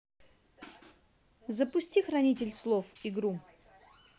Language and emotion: Russian, neutral